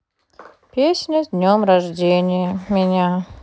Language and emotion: Russian, sad